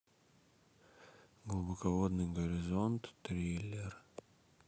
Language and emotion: Russian, sad